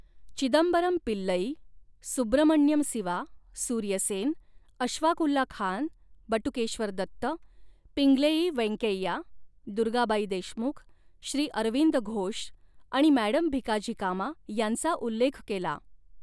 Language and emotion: Marathi, neutral